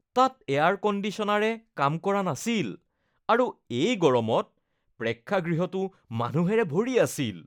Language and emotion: Assamese, disgusted